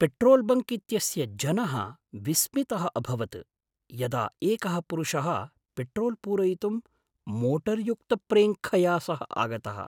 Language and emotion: Sanskrit, surprised